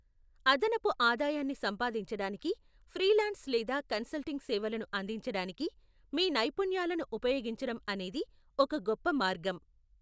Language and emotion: Telugu, neutral